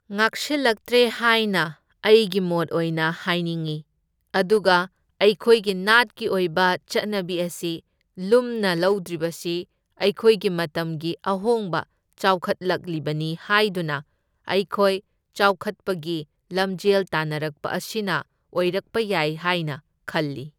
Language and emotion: Manipuri, neutral